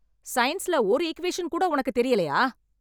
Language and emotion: Tamil, angry